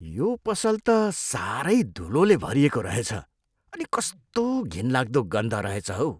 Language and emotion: Nepali, disgusted